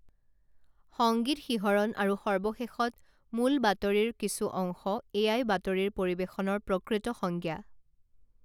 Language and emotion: Assamese, neutral